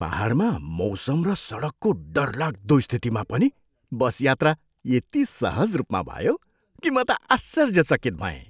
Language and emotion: Nepali, surprised